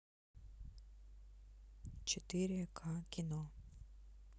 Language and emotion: Russian, neutral